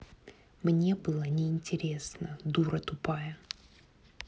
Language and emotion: Russian, angry